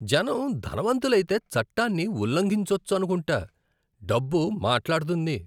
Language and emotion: Telugu, disgusted